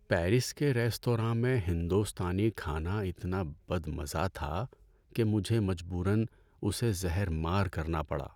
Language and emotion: Urdu, sad